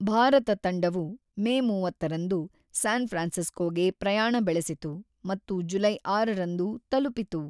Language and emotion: Kannada, neutral